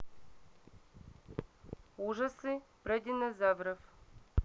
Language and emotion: Russian, neutral